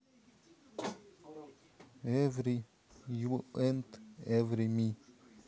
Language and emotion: Russian, neutral